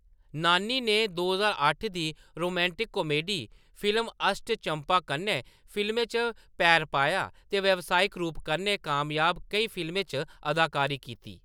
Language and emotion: Dogri, neutral